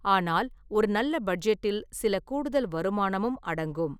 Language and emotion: Tamil, neutral